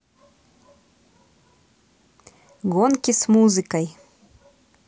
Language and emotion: Russian, positive